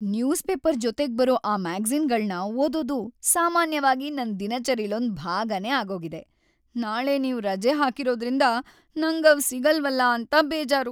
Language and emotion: Kannada, sad